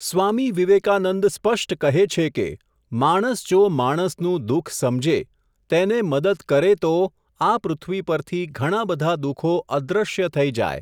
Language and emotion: Gujarati, neutral